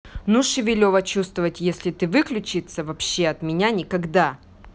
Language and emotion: Russian, angry